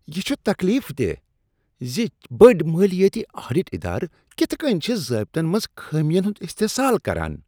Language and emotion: Kashmiri, disgusted